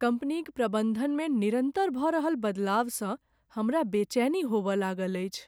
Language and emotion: Maithili, sad